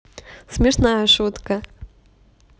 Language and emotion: Russian, positive